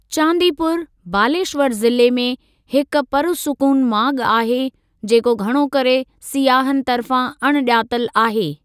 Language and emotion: Sindhi, neutral